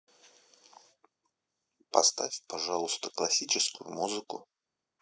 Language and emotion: Russian, neutral